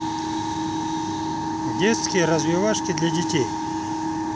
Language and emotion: Russian, neutral